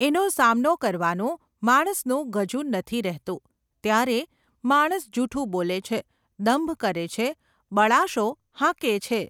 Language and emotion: Gujarati, neutral